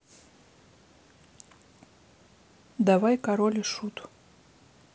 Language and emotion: Russian, neutral